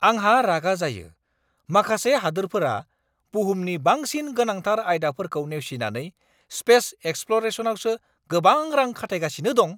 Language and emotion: Bodo, angry